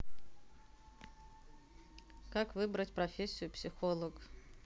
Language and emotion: Russian, neutral